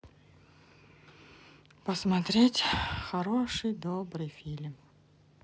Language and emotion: Russian, sad